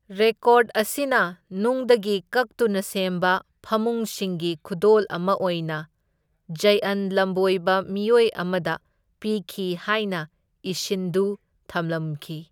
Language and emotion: Manipuri, neutral